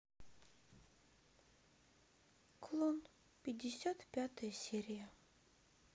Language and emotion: Russian, sad